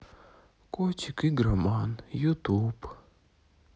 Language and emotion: Russian, sad